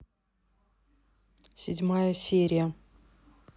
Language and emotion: Russian, neutral